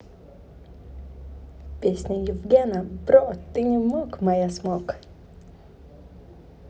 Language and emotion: Russian, positive